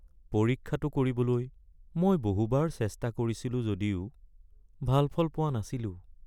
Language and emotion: Assamese, sad